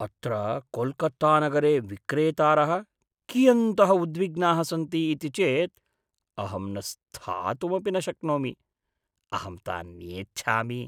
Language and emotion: Sanskrit, disgusted